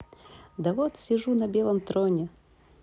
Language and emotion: Russian, positive